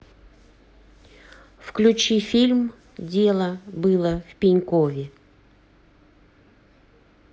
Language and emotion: Russian, neutral